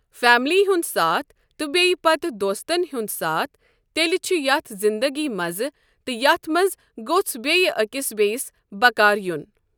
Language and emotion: Kashmiri, neutral